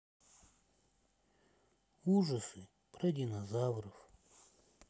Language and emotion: Russian, sad